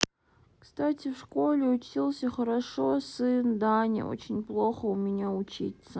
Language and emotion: Russian, sad